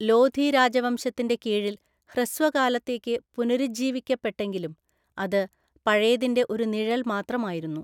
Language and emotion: Malayalam, neutral